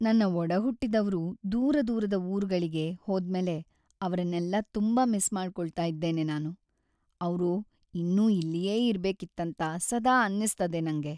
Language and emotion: Kannada, sad